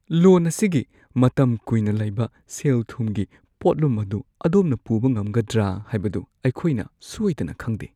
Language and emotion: Manipuri, fearful